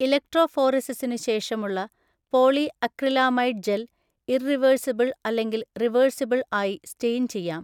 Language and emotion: Malayalam, neutral